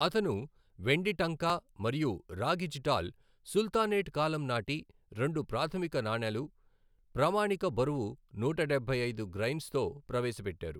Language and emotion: Telugu, neutral